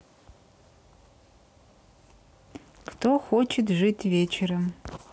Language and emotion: Russian, neutral